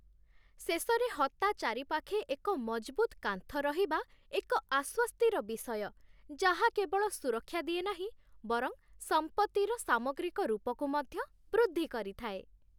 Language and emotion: Odia, happy